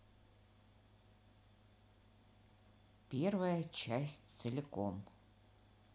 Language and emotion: Russian, neutral